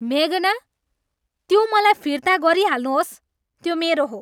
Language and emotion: Nepali, angry